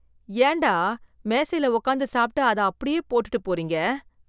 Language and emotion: Tamil, disgusted